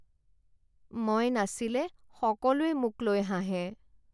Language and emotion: Assamese, sad